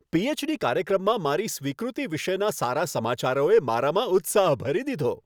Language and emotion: Gujarati, happy